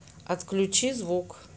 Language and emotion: Russian, neutral